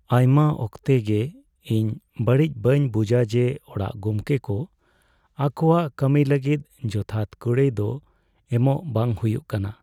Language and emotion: Santali, sad